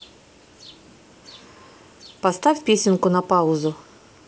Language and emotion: Russian, neutral